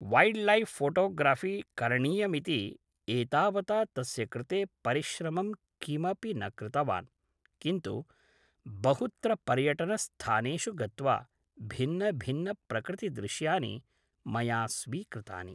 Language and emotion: Sanskrit, neutral